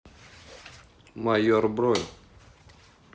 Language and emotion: Russian, neutral